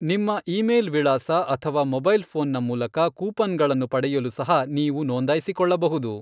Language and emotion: Kannada, neutral